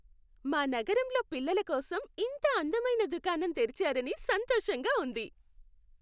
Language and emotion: Telugu, happy